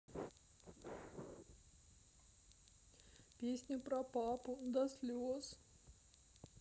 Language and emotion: Russian, sad